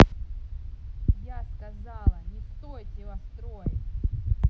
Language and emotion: Russian, angry